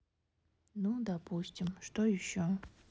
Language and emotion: Russian, sad